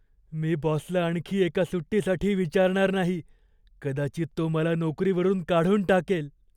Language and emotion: Marathi, fearful